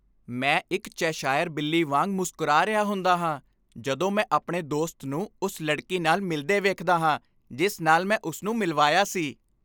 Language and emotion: Punjabi, happy